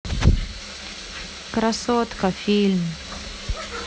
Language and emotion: Russian, sad